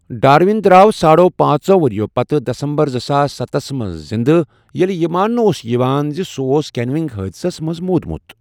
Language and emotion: Kashmiri, neutral